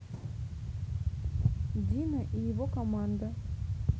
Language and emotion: Russian, neutral